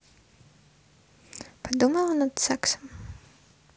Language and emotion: Russian, neutral